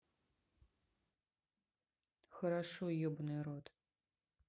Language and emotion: Russian, neutral